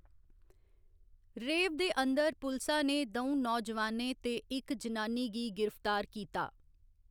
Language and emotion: Dogri, neutral